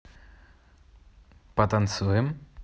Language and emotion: Russian, positive